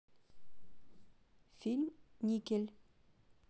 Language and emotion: Russian, neutral